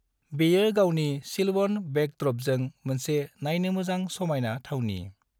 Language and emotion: Bodo, neutral